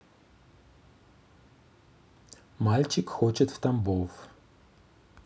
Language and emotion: Russian, neutral